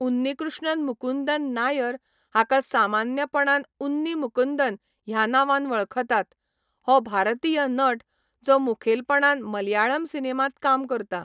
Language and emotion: Goan Konkani, neutral